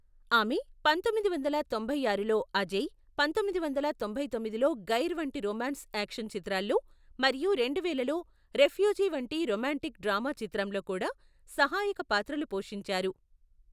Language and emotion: Telugu, neutral